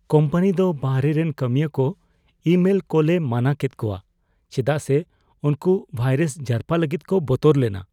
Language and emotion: Santali, fearful